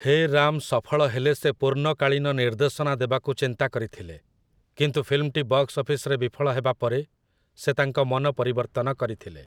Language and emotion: Odia, neutral